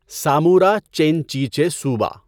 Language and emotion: Urdu, neutral